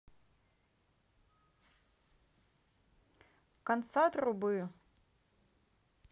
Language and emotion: Russian, neutral